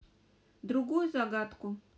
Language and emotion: Russian, neutral